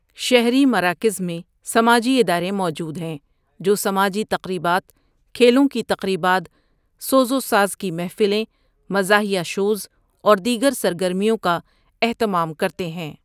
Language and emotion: Urdu, neutral